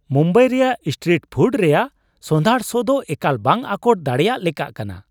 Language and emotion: Santali, surprised